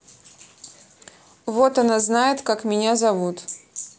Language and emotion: Russian, neutral